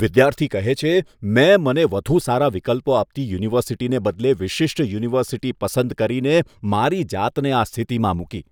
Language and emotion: Gujarati, disgusted